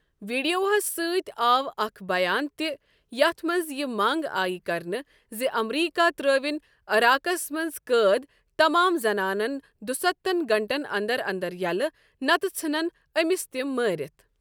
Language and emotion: Kashmiri, neutral